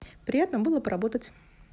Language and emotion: Russian, positive